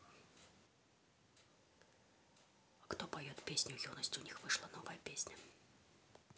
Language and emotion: Russian, neutral